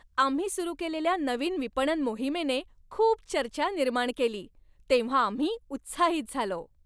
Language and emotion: Marathi, happy